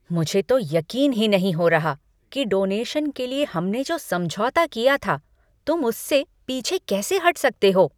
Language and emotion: Hindi, angry